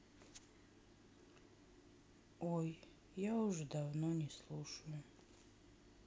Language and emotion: Russian, sad